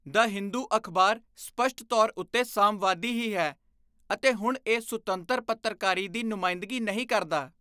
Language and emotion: Punjabi, disgusted